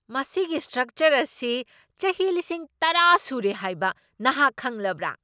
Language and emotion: Manipuri, surprised